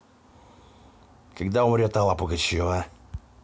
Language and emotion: Russian, angry